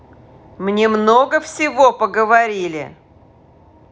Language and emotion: Russian, angry